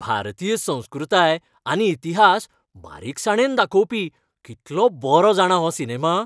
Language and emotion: Goan Konkani, happy